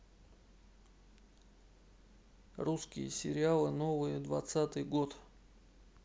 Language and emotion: Russian, neutral